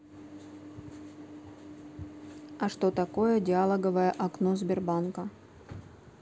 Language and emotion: Russian, neutral